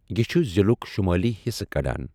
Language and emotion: Kashmiri, neutral